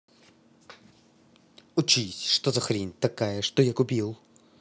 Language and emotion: Russian, angry